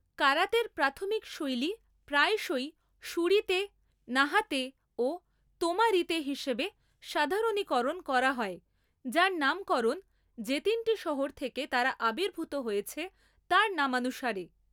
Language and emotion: Bengali, neutral